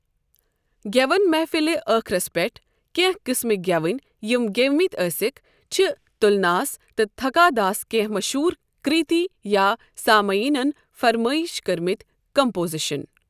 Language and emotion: Kashmiri, neutral